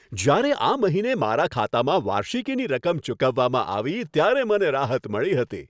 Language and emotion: Gujarati, happy